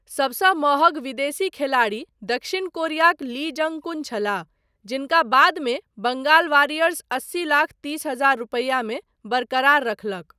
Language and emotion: Maithili, neutral